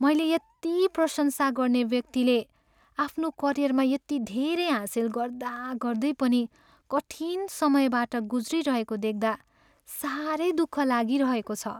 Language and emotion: Nepali, sad